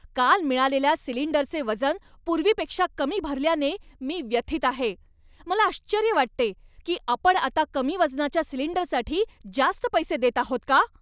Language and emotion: Marathi, angry